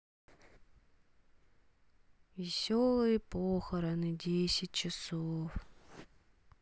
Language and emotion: Russian, sad